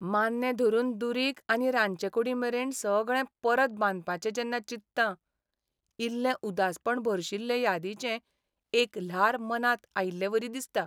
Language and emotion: Goan Konkani, sad